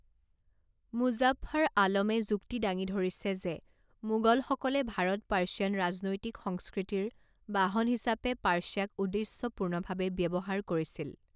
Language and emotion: Assamese, neutral